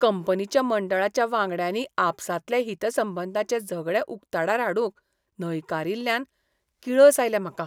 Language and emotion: Goan Konkani, disgusted